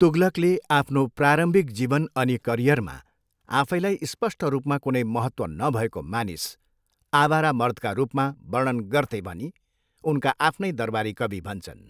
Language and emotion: Nepali, neutral